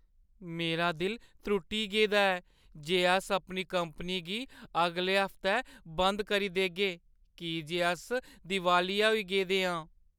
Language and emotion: Dogri, sad